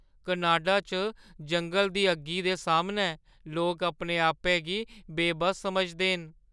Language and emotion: Dogri, fearful